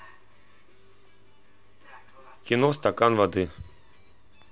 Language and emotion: Russian, neutral